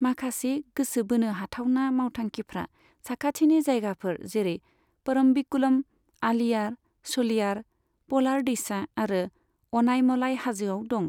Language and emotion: Bodo, neutral